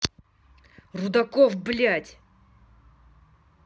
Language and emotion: Russian, angry